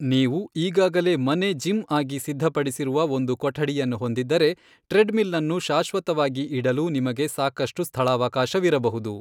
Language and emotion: Kannada, neutral